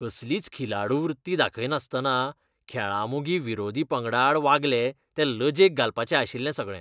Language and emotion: Goan Konkani, disgusted